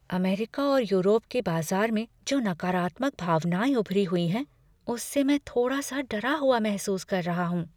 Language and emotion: Hindi, fearful